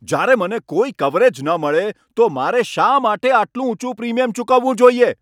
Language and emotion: Gujarati, angry